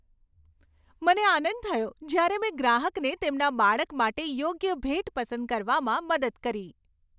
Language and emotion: Gujarati, happy